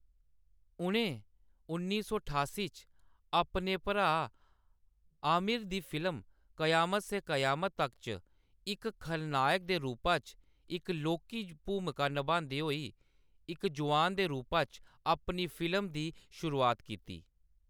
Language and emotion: Dogri, neutral